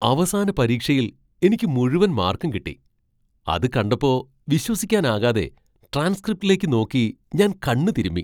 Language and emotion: Malayalam, surprised